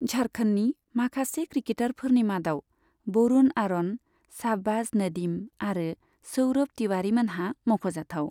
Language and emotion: Bodo, neutral